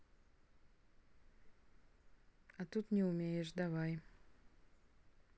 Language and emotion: Russian, neutral